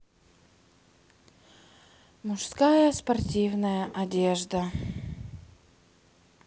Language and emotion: Russian, sad